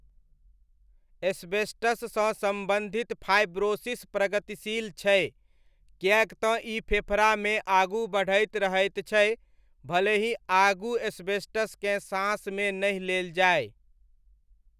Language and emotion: Maithili, neutral